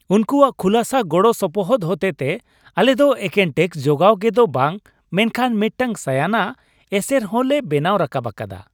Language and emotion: Santali, happy